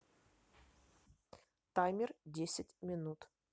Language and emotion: Russian, neutral